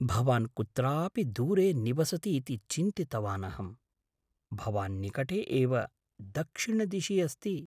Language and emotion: Sanskrit, surprised